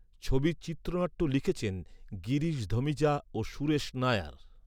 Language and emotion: Bengali, neutral